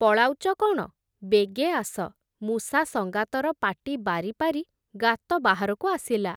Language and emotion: Odia, neutral